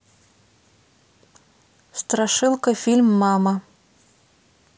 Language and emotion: Russian, neutral